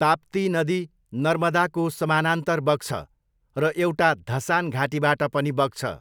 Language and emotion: Nepali, neutral